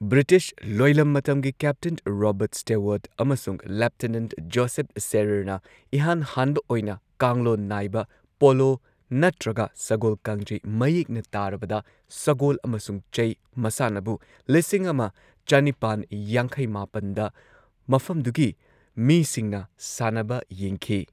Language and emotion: Manipuri, neutral